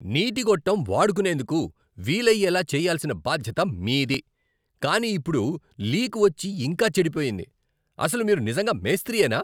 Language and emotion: Telugu, angry